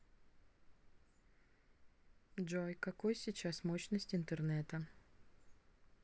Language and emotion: Russian, neutral